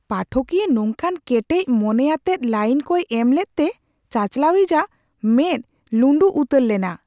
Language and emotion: Santali, surprised